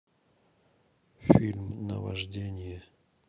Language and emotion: Russian, neutral